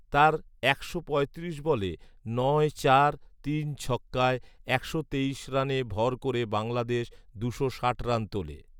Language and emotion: Bengali, neutral